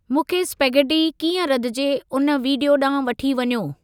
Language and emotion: Sindhi, neutral